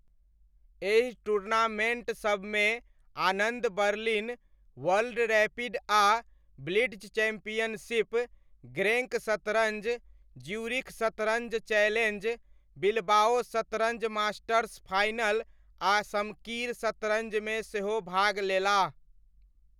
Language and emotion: Maithili, neutral